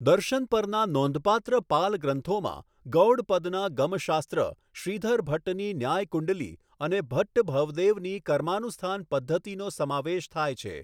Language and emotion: Gujarati, neutral